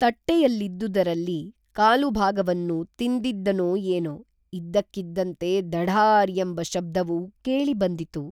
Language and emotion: Kannada, neutral